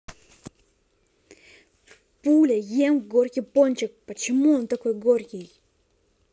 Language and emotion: Russian, angry